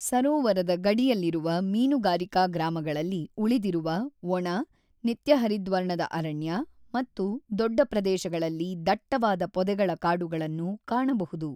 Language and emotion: Kannada, neutral